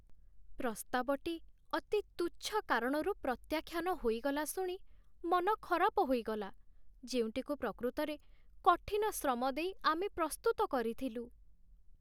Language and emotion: Odia, sad